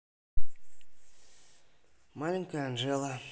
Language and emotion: Russian, neutral